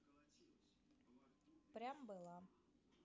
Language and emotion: Russian, neutral